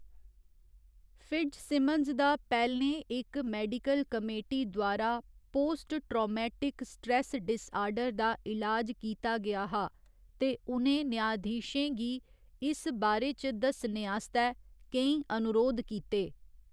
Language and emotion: Dogri, neutral